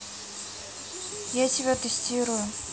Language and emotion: Russian, neutral